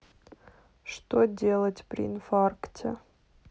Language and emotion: Russian, sad